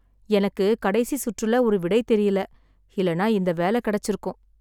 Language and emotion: Tamil, sad